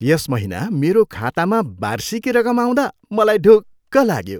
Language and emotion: Nepali, happy